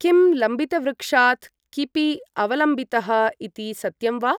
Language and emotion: Sanskrit, neutral